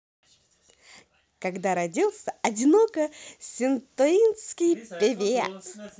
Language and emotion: Russian, positive